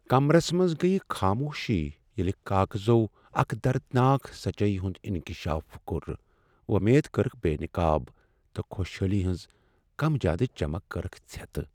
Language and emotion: Kashmiri, sad